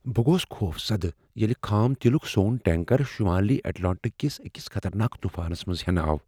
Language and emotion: Kashmiri, fearful